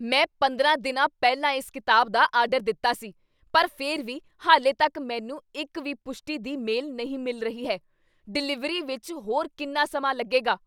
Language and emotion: Punjabi, angry